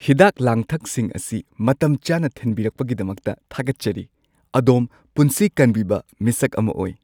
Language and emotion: Manipuri, happy